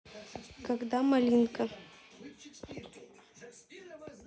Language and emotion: Russian, neutral